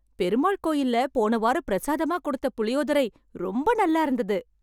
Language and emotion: Tamil, happy